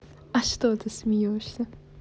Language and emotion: Russian, positive